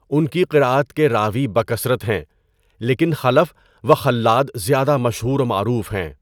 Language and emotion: Urdu, neutral